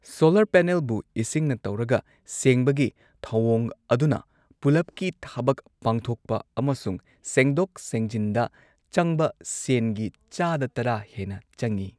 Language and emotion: Manipuri, neutral